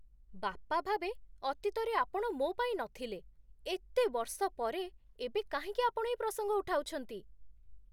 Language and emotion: Odia, surprised